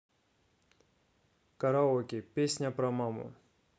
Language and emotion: Russian, neutral